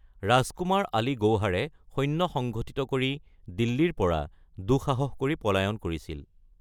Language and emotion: Assamese, neutral